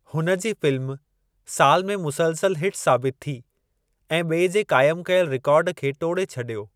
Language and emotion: Sindhi, neutral